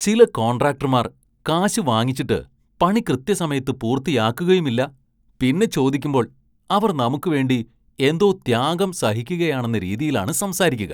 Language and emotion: Malayalam, disgusted